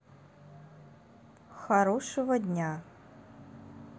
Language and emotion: Russian, neutral